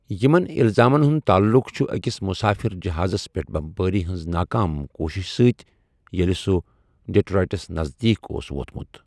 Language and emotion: Kashmiri, neutral